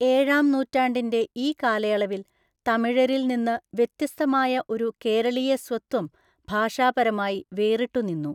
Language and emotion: Malayalam, neutral